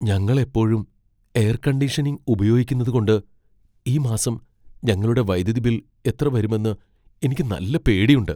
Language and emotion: Malayalam, fearful